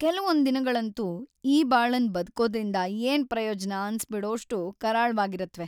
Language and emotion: Kannada, sad